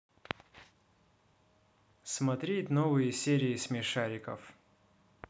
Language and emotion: Russian, neutral